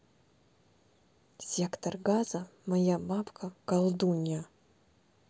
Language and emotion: Russian, neutral